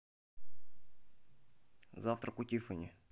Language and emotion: Russian, neutral